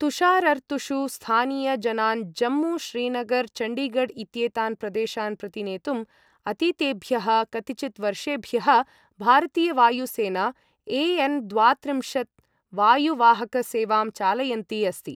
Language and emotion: Sanskrit, neutral